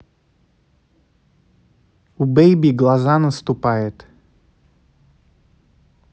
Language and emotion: Russian, neutral